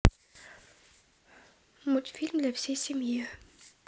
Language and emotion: Russian, neutral